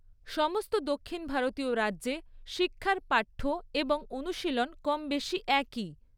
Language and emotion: Bengali, neutral